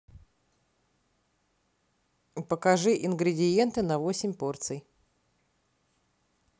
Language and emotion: Russian, neutral